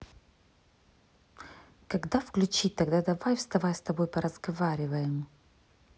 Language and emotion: Russian, neutral